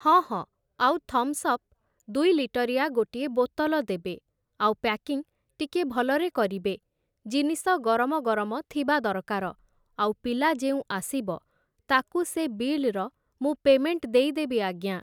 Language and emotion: Odia, neutral